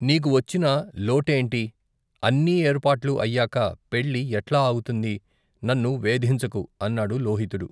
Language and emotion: Telugu, neutral